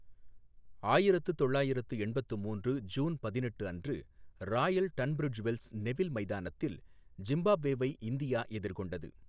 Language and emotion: Tamil, neutral